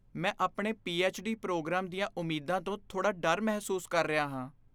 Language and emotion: Punjabi, fearful